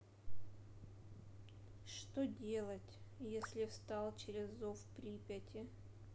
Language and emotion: Russian, sad